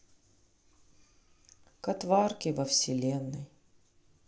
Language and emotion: Russian, sad